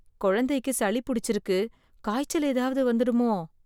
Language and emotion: Tamil, fearful